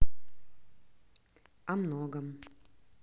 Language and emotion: Russian, neutral